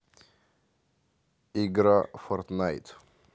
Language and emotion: Russian, neutral